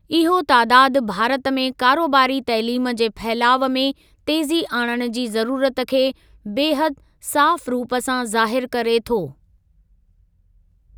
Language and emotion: Sindhi, neutral